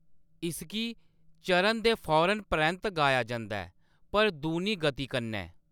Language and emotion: Dogri, neutral